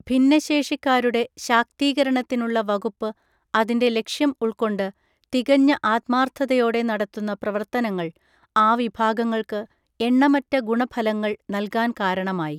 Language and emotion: Malayalam, neutral